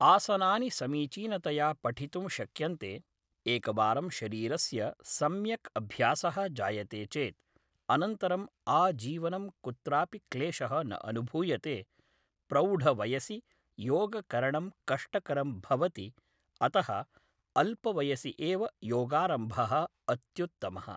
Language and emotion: Sanskrit, neutral